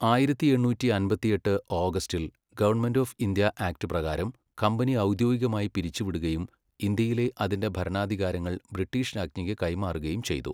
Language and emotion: Malayalam, neutral